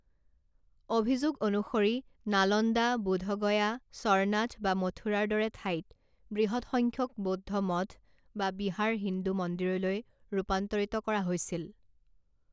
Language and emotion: Assamese, neutral